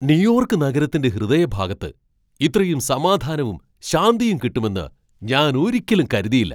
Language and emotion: Malayalam, surprised